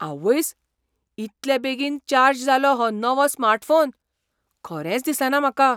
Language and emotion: Goan Konkani, surprised